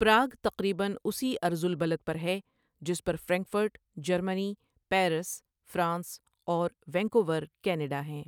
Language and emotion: Urdu, neutral